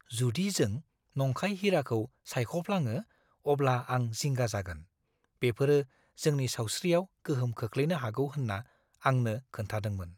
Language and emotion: Bodo, fearful